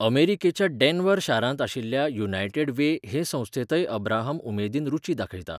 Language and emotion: Goan Konkani, neutral